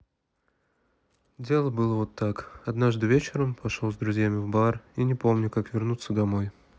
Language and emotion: Russian, sad